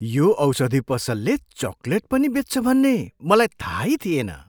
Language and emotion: Nepali, surprised